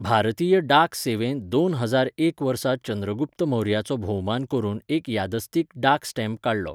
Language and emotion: Goan Konkani, neutral